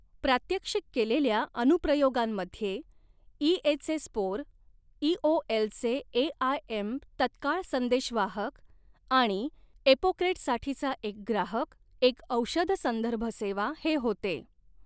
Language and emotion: Marathi, neutral